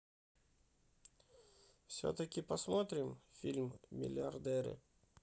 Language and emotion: Russian, neutral